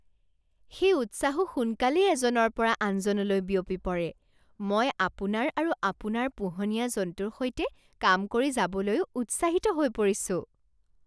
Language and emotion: Assamese, surprised